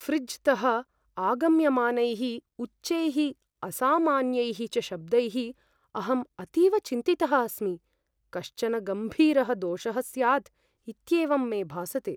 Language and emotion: Sanskrit, fearful